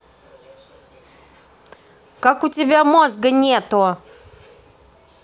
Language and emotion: Russian, angry